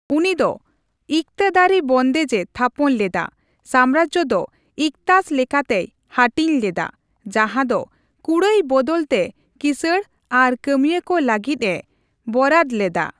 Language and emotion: Santali, neutral